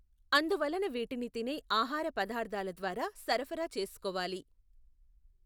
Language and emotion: Telugu, neutral